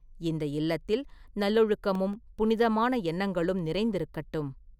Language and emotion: Tamil, neutral